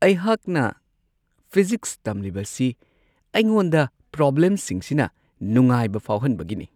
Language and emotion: Manipuri, happy